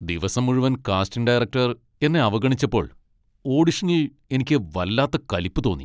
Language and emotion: Malayalam, angry